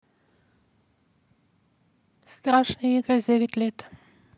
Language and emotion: Russian, neutral